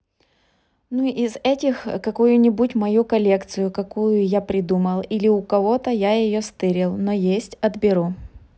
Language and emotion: Russian, neutral